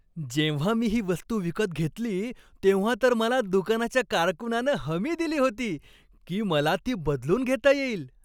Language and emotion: Marathi, happy